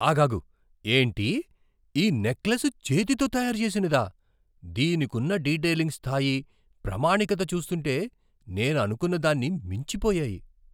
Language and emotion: Telugu, surprised